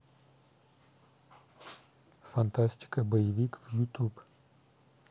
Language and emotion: Russian, neutral